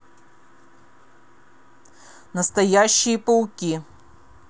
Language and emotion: Russian, angry